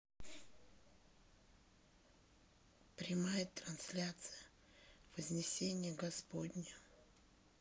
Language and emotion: Russian, sad